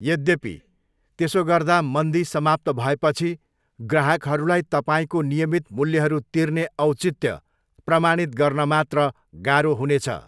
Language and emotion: Nepali, neutral